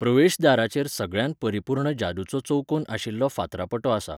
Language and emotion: Goan Konkani, neutral